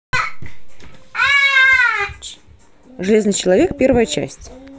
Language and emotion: Russian, neutral